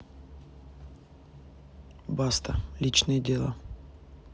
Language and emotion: Russian, neutral